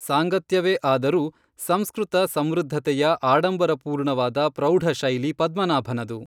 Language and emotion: Kannada, neutral